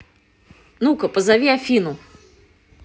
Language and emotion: Russian, angry